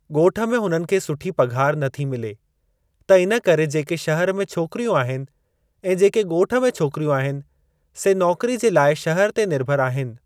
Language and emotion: Sindhi, neutral